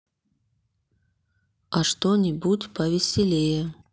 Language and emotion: Russian, neutral